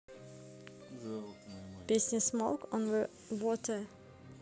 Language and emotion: Russian, neutral